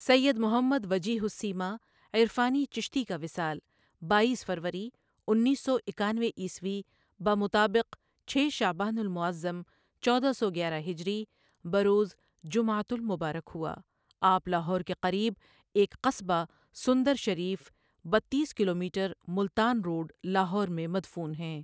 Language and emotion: Urdu, neutral